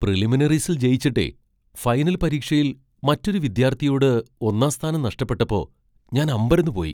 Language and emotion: Malayalam, surprised